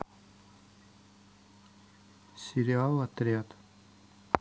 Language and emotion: Russian, neutral